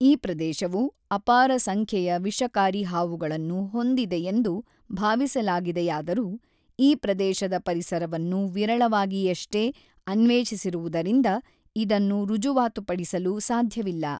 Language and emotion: Kannada, neutral